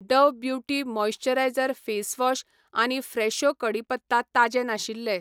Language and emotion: Goan Konkani, neutral